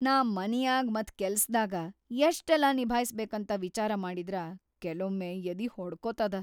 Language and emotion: Kannada, fearful